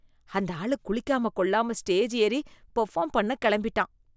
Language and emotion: Tamil, disgusted